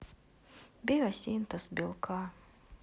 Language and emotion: Russian, sad